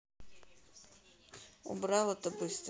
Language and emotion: Russian, neutral